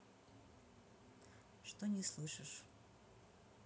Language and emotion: Russian, neutral